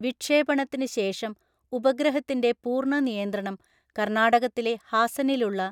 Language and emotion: Malayalam, neutral